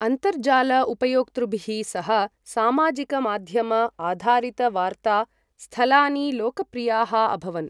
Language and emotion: Sanskrit, neutral